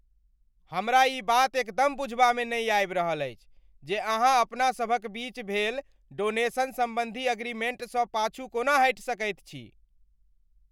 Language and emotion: Maithili, angry